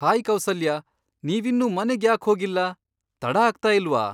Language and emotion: Kannada, surprised